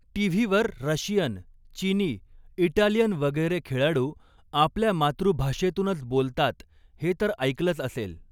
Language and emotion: Marathi, neutral